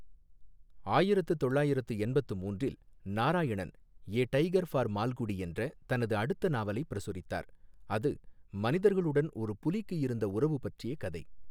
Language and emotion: Tamil, neutral